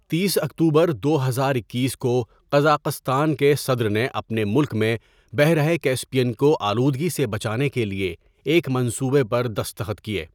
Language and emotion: Urdu, neutral